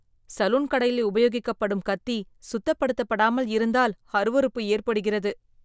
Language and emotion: Tamil, disgusted